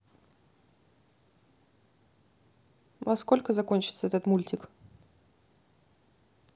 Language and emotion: Russian, neutral